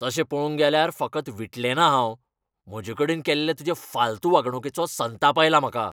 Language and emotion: Goan Konkani, angry